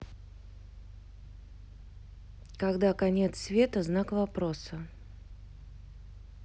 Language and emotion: Russian, neutral